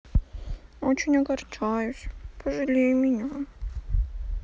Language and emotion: Russian, sad